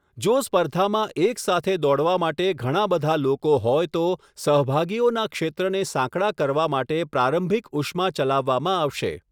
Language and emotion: Gujarati, neutral